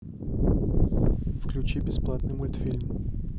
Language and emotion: Russian, neutral